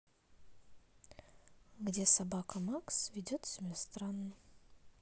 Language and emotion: Russian, neutral